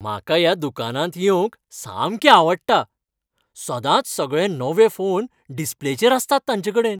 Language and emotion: Goan Konkani, happy